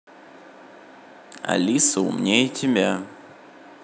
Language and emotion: Russian, neutral